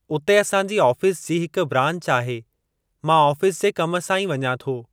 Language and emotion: Sindhi, neutral